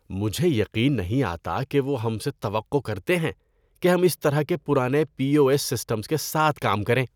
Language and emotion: Urdu, disgusted